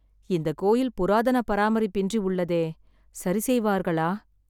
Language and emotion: Tamil, sad